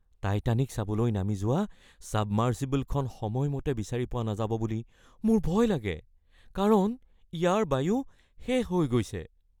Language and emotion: Assamese, fearful